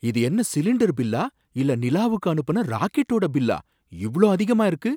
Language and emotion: Tamil, surprised